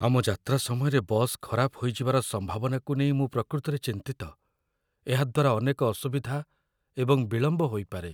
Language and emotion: Odia, fearful